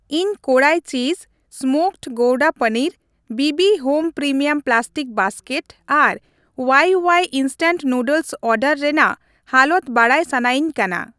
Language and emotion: Santali, neutral